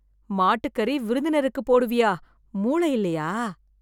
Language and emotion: Tamil, disgusted